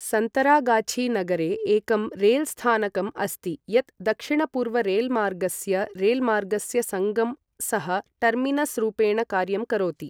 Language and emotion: Sanskrit, neutral